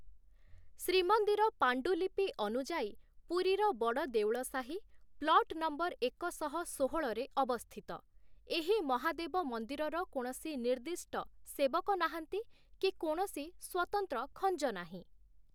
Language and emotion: Odia, neutral